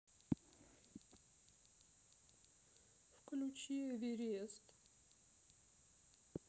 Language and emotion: Russian, sad